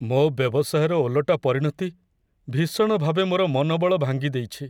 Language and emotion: Odia, sad